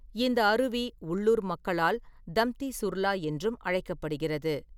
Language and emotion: Tamil, neutral